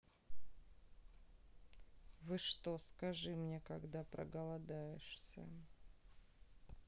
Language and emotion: Russian, neutral